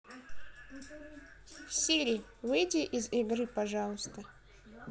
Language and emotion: Russian, neutral